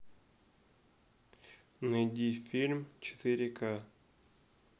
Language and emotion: Russian, neutral